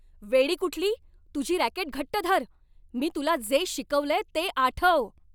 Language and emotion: Marathi, angry